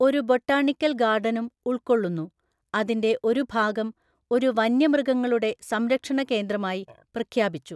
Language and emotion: Malayalam, neutral